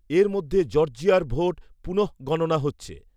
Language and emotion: Bengali, neutral